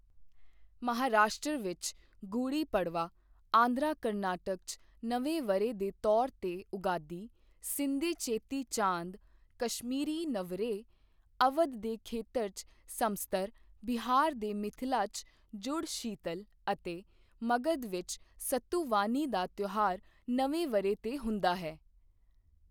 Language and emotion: Punjabi, neutral